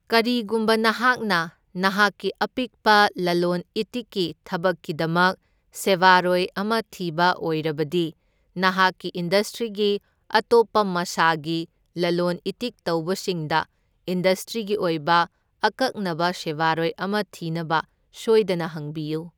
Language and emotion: Manipuri, neutral